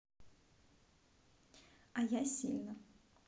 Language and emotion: Russian, neutral